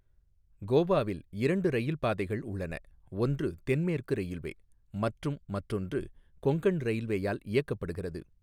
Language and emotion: Tamil, neutral